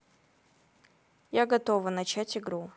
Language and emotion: Russian, neutral